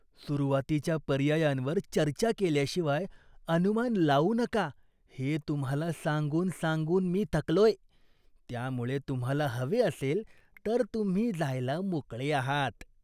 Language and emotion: Marathi, disgusted